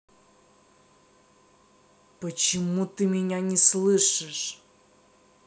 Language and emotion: Russian, angry